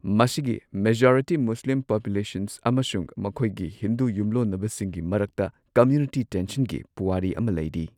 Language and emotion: Manipuri, neutral